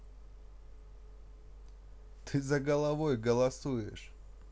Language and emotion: Russian, neutral